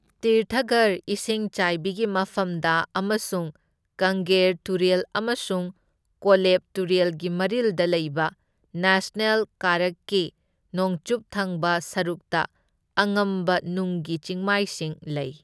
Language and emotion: Manipuri, neutral